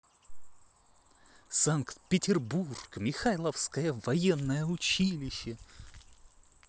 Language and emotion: Russian, positive